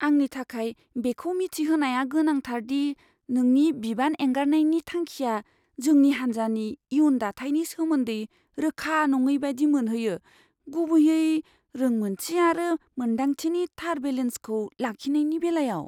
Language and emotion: Bodo, fearful